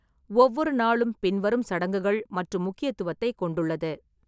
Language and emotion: Tamil, neutral